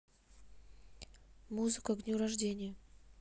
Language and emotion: Russian, neutral